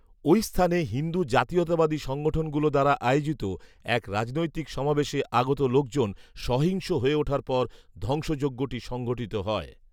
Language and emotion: Bengali, neutral